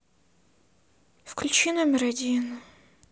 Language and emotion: Russian, sad